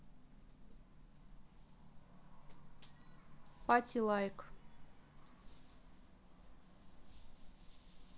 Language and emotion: Russian, neutral